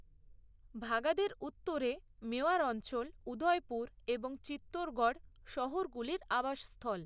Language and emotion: Bengali, neutral